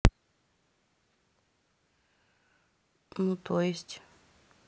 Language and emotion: Russian, neutral